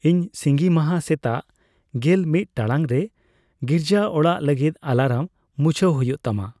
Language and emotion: Santali, neutral